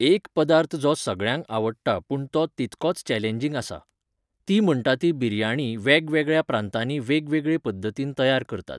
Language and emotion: Goan Konkani, neutral